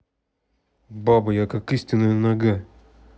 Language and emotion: Russian, neutral